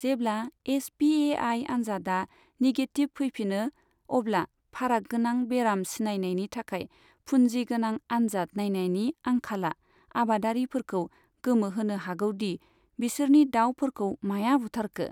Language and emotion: Bodo, neutral